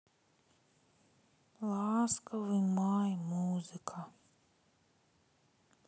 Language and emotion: Russian, sad